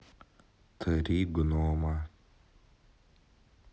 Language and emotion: Russian, neutral